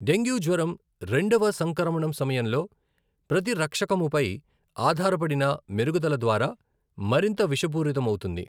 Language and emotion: Telugu, neutral